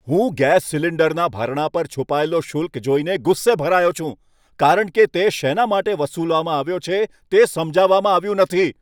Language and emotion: Gujarati, angry